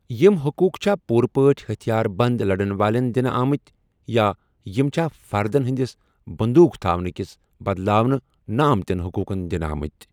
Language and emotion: Kashmiri, neutral